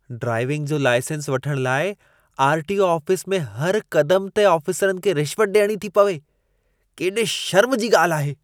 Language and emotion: Sindhi, disgusted